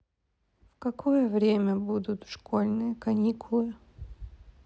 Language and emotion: Russian, sad